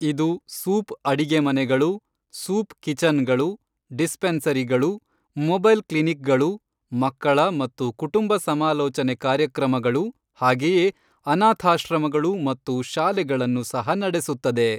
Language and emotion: Kannada, neutral